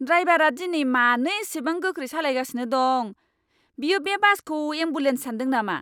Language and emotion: Bodo, angry